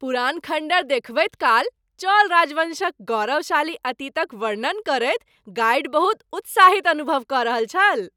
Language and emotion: Maithili, happy